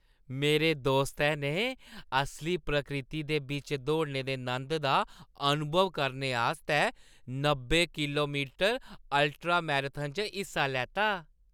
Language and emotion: Dogri, happy